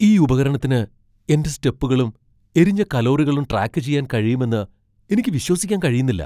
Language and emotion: Malayalam, surprised